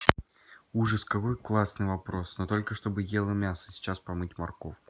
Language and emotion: Russian, neutral